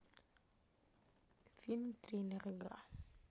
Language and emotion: Russian, neutral